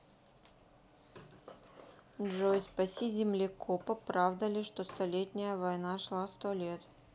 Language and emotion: Russian, neutral